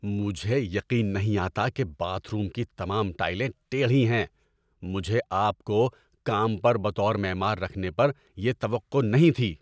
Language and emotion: Urdu, angry